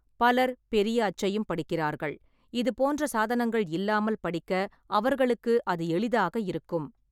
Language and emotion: Tamil, neutral